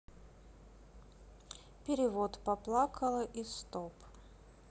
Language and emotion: Russian, neutral